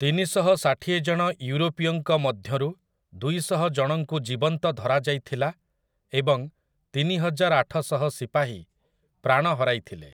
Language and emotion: Odia, neutral